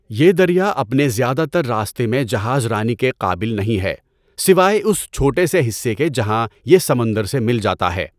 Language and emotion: Urdu, neutral